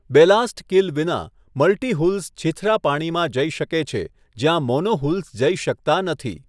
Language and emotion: Gujarati, neutral